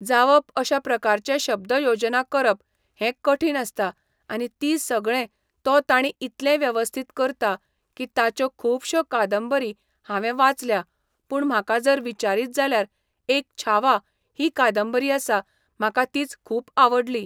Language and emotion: Goan Konkani, neutral